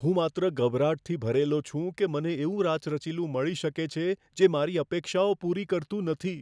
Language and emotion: Gujarati, fearful